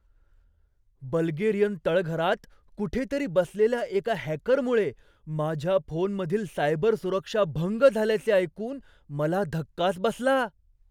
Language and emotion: Marathi, surprised